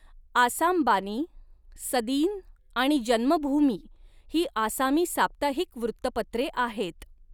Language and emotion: Marathi, neutral